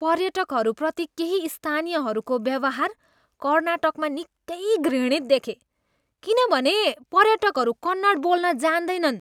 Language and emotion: Nepali, disgusted